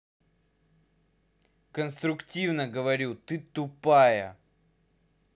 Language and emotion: Russian, angry